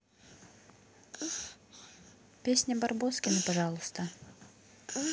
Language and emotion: Russian, neutral